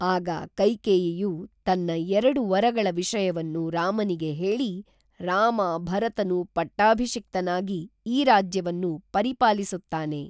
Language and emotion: Kannada, neutral